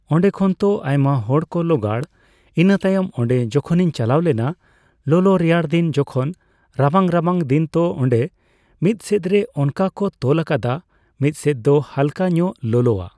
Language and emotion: Santali, neutral